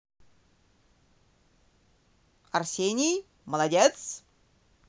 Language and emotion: Russian, positive